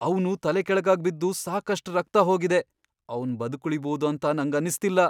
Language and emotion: Kannada, fearful